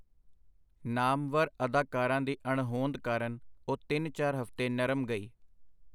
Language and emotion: Punjabi, neutral